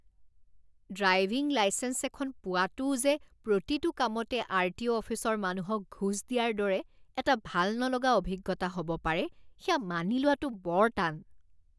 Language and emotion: Assamese, disgusted